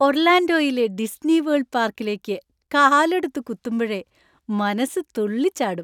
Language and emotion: Malayalam, happy